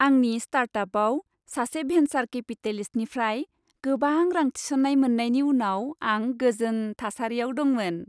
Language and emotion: Bodo, happy